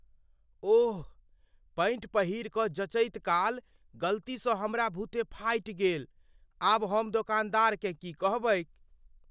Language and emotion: Maithili, fearful